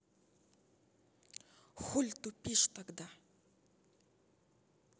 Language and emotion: Russian, angry